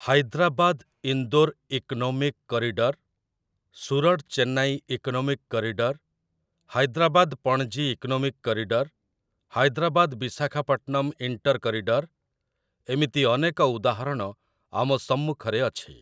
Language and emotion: Odia, neutral